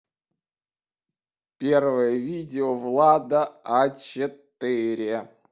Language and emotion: Russian, neutral